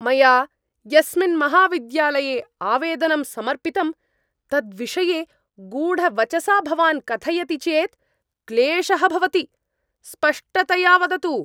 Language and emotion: Sanskrit, angry